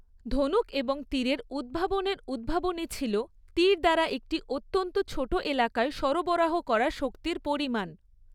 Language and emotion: Bengali, neutral